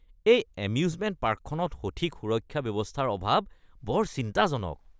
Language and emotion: Assamese, disgusted